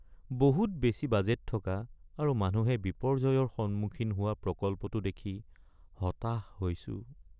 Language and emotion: Assamese, sad